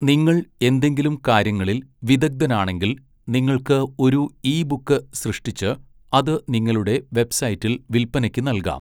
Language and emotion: Malayalam, neutral